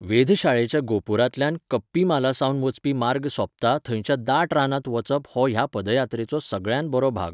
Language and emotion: Goan Konkani, neutral